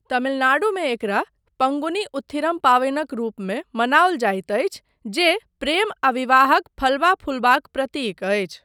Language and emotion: Maithili, neutral